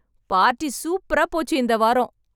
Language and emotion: Tamil, happy